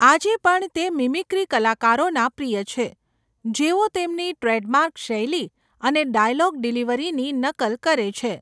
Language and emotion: Gujarati, neutral